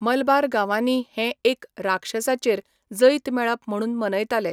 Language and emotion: Goan Konkani, neutral